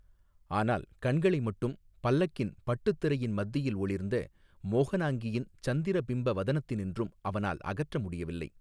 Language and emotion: Tamil, neutral